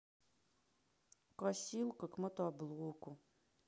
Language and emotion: Russian, sad